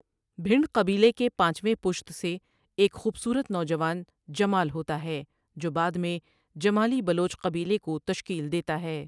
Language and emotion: Urdu, neutral